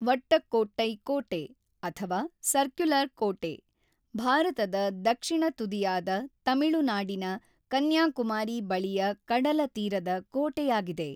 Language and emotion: Kannada, neutral